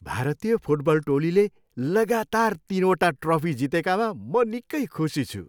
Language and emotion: Nepali, happy